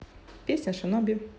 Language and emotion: Russian, neutral